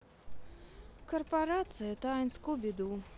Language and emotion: Russian, sad